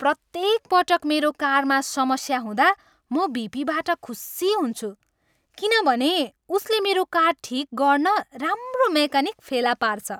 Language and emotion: Nepali, happy